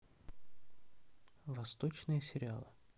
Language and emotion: Russian, neutral